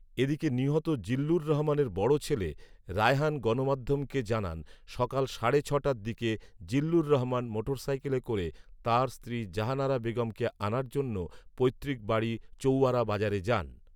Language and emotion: Bengali, neutral